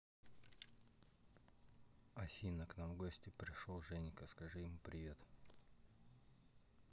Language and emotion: Russian, neutral